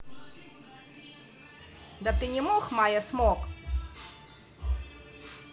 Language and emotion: Russian, neutral